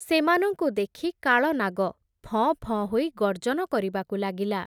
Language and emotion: Odia, neutral